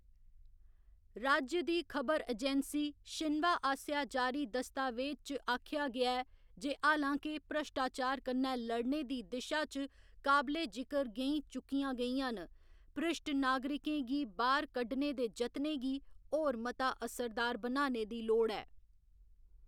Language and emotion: Dogri, neutral